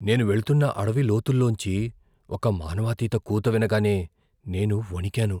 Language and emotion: Telugu, fearful